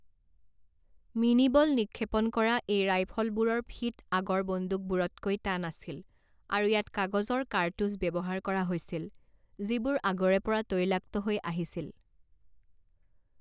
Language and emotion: Assamese, neutral